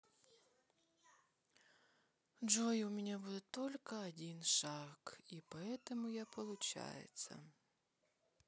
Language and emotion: Russian, sad